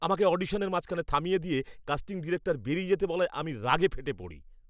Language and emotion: Bengali, angry